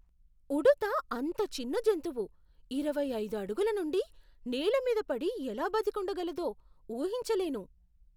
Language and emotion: Telugu, surprised